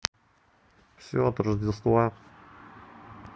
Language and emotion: Russian, neutral